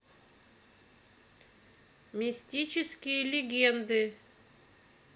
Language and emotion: Russian, neutral